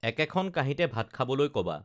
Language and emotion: Assamese, neutral